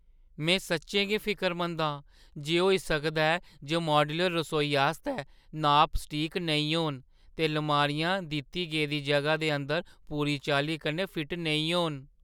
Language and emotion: Dogri, fearful